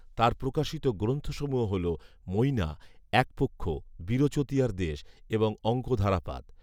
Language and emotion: Bengali, neutral